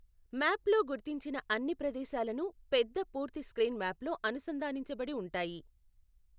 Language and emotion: Telugu, neutral